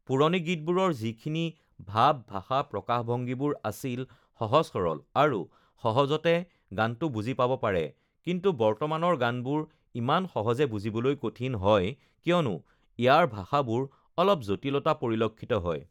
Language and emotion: Assamese, neutral